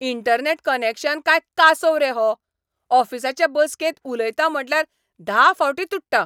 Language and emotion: Goan Konkani, angry